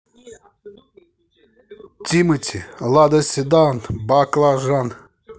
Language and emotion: Russian, positive